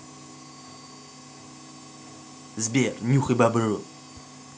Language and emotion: Russian, angry